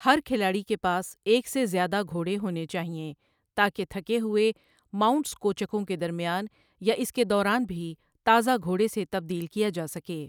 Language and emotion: Urdu, neutral